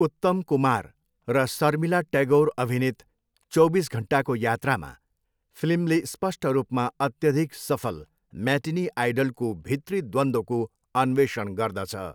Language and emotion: Nepali, neutral